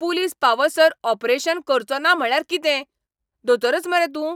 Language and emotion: Goan Konkani, angry